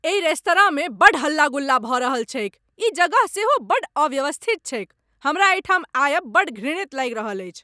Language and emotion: Maithili, angry